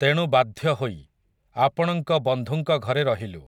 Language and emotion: Odia, neutral